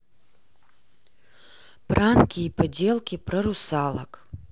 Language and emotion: Russian, neutral